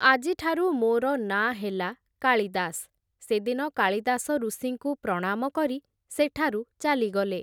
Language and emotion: Odia, neutral